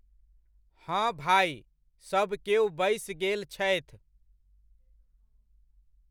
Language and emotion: Maithili, neutral